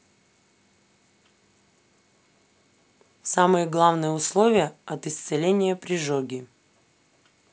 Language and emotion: Russian, neutral